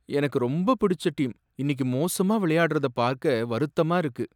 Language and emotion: Tamil, sad